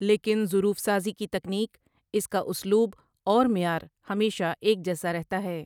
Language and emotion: Urdu, neutral